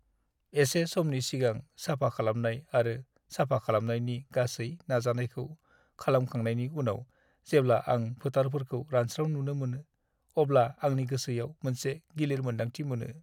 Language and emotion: Bodo, sad